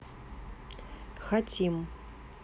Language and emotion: Russian, neutral